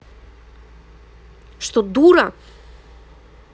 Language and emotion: Russian, angry